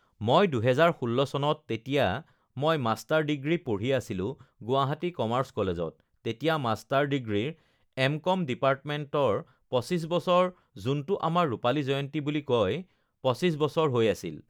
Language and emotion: Assamese, neutral